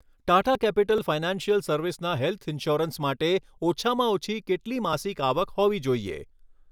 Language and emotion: Gujarati, neutral